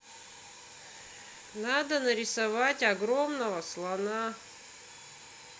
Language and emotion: Russian, neutral